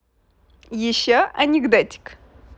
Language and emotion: Russian, positive